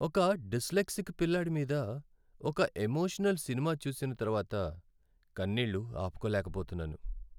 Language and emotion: Telugu, sad